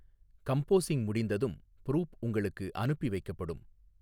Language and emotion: Tamil, neutral